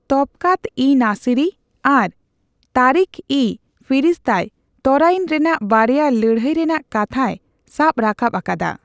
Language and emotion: Santali, neutral